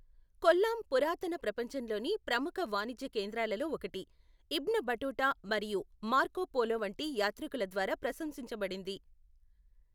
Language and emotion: Telugu, neutral